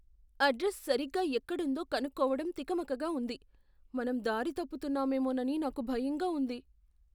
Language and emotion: Telugu, fearful